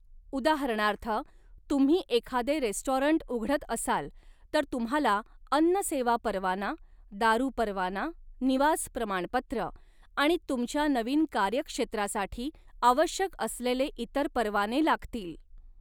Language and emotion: Marathi, neutral